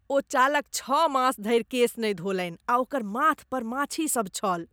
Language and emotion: Maithili, disgusted